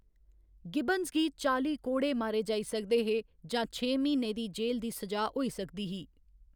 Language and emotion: Dogri, neutral